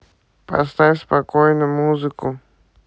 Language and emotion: Russian, neutral